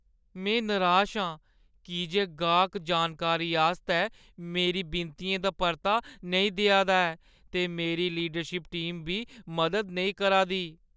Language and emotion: Dogri, sad